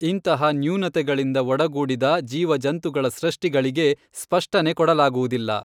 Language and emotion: Kannada, neutral